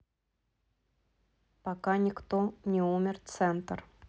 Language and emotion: Russian, neutral